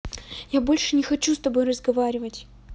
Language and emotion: Russian, neutral